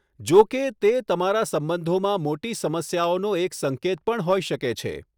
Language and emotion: Gujarati, neutral